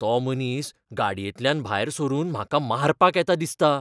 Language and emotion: Goan Konkani, fearful